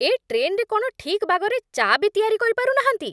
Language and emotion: Odia, angry